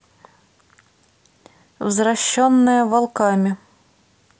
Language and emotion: Russian, neutral